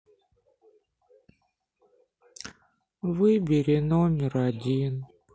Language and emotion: Russian, sad